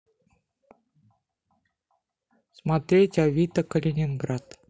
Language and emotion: Russian, neutral